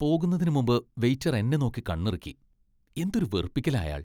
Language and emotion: Malayalam, disgusted